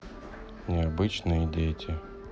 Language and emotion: Russian, neutral